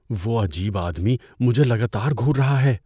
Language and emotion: Urdu, fearful